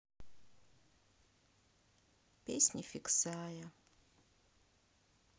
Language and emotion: Russian, sad